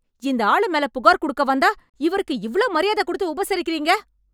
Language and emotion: Tamil, angry